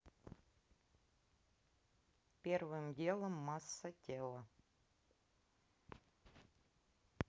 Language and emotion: Russian, neutral